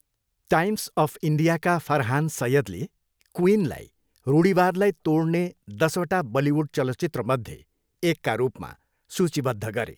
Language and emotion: Nepali, neutral